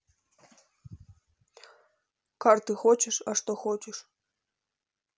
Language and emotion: Russian, neutral